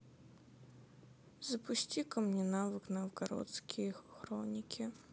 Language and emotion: Russian, sad